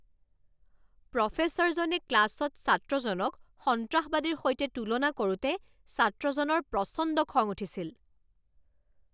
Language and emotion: Assamese, angry